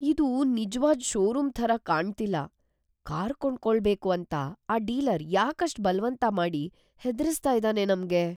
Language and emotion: Kannada, fearful